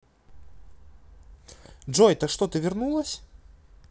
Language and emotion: Russian, positive